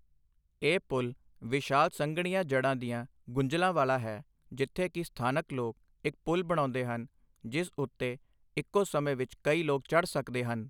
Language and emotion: Punjabi, neutral